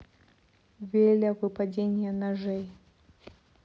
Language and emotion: Russian, sad